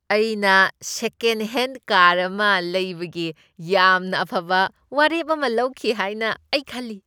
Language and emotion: Manipuri, happy